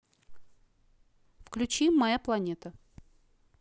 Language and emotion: Russian, neutral